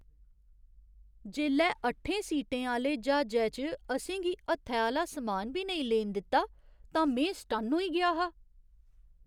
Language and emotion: Dogri, surprised